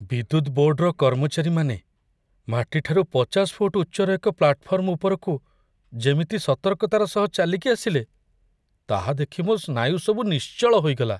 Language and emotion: Odia, fearful